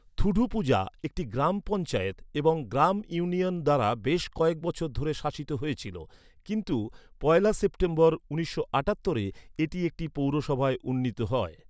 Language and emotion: Bengali, neutral